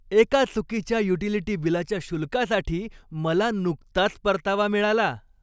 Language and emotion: Marathi, happy